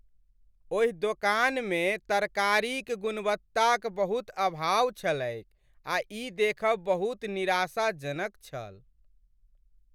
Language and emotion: Maithili, sad